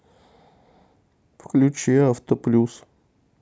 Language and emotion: Russian, neutral